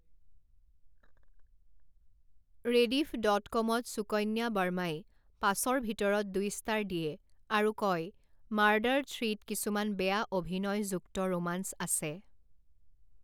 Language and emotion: Assamese, neutral